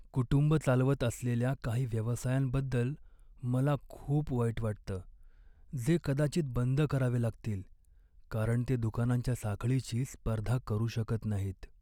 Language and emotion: Marathi, sad